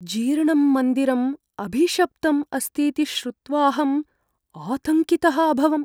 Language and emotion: Sanskrit, fearful